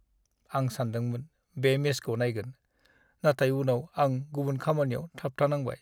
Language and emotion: Bodo, sad